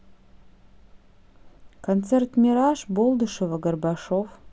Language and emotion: Russian, neutral